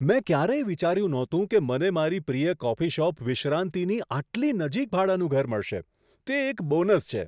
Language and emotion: Gujarati, surprised